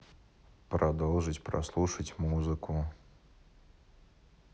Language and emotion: Russian, neutral